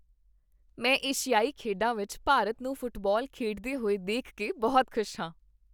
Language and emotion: Punjabi, happy